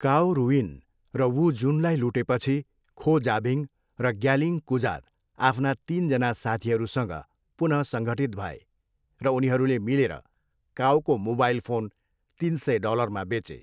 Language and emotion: Nepali, neutral